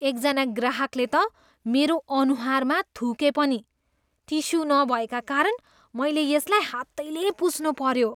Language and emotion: Nepali, disgusted